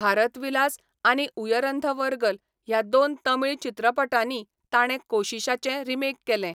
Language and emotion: Goan Konkani, neutral